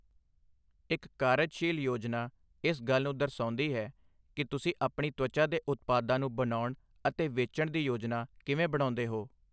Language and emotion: Punjabi, neutral